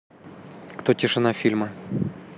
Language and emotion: Russian, neutral